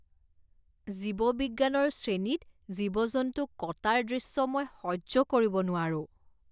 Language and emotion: Assamese, disgusted